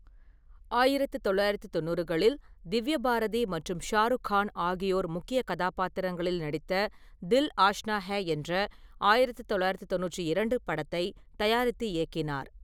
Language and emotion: Tamil, neutral